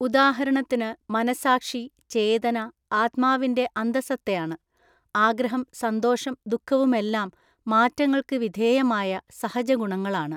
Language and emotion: Malayalam, neutral